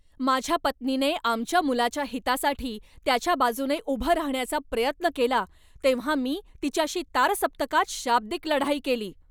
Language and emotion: Marathi, angry